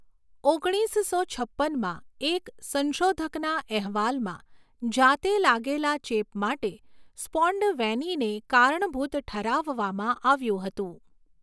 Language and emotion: Gujarati, neutral